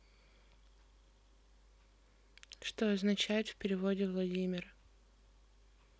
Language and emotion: Russian, neutral